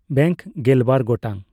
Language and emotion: Santali, neutral